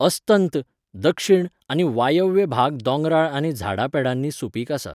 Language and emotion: Goan Konkani, neutral